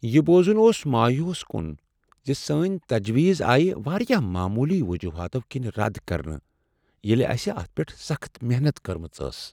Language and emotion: Kashmiri, sad